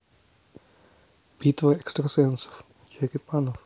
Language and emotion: Russian, neutral